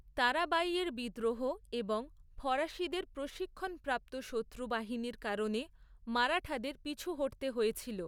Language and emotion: Bengali, neutral